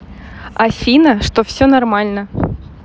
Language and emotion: Russian, positive